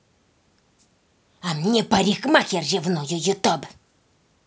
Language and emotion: Russian, angry